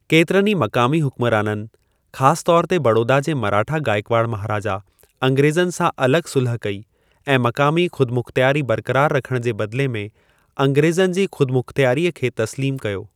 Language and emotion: Sindhi, neutral